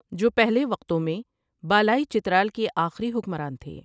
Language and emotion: Urdu, neutral